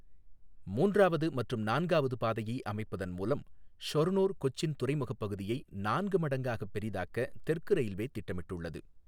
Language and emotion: Tamil, neutral